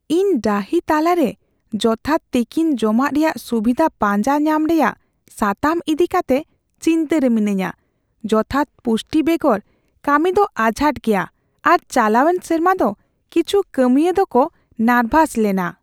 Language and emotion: Santali, fearful